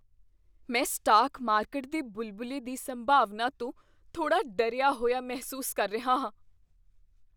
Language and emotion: Punjabi, fearful